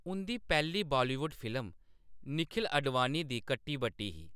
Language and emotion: Dogri, neutral